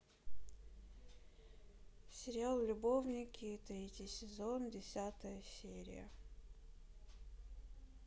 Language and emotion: Russian, sad